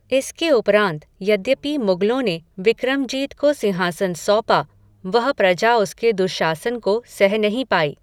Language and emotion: Hindi, neutral